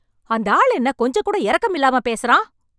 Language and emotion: Tamil, angry